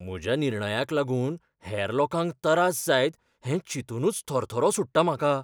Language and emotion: Goan Konkani, fearful